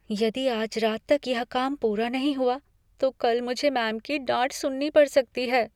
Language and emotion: Hindi, fearful